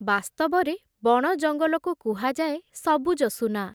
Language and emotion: Odia, neutral